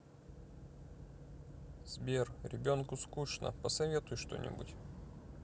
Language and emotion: Russian, sad